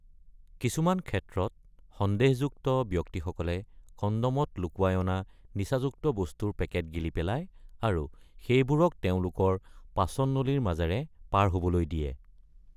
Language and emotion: Assamese, neutral